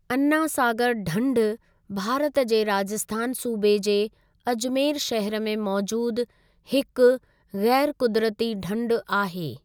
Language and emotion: Sindhi, neutral